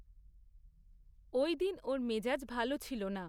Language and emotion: Bengali, neutral